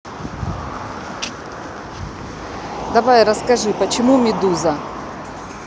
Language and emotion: Russian, neutral